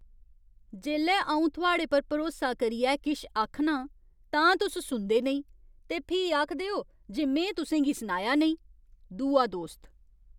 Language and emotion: Dogri, disgusted